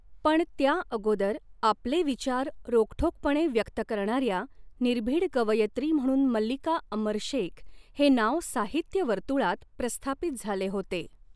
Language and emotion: Marathi, neutral